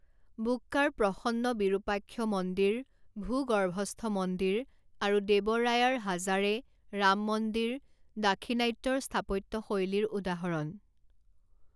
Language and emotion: Assamese, neutral